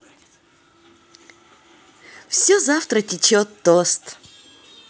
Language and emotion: Russian, positive